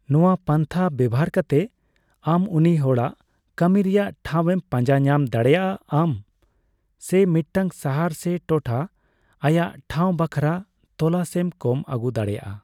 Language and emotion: Santali, neutral